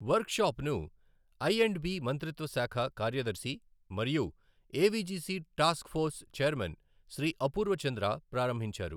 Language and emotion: Telugu, neutral